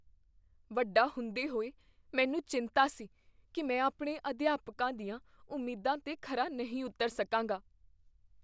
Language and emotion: Punjabi, fearful